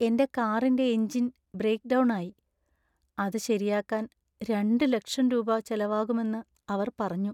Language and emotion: Malayalam, sad